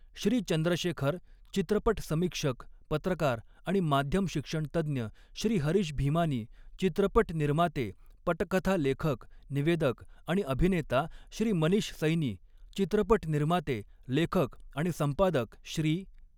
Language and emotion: Marathi, neutral